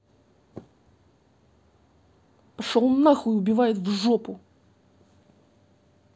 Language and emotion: Russian, angry